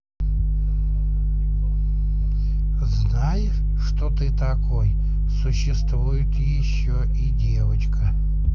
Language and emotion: Russian, neutral